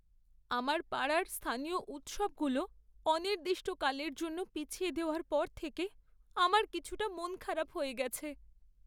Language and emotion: Bengali, sad